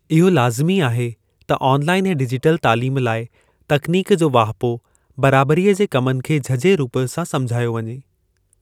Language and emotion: Sindhi, neutral